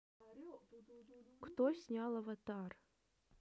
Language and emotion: Russian, neutral